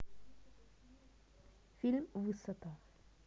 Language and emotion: Russian, neutral